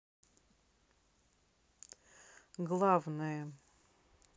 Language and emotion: Russian, neutral